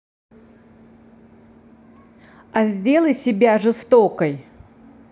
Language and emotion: Russian, neutral